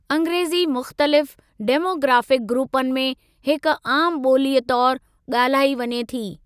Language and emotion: Sindhi, neutral